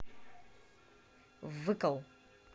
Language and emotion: Russian, neutral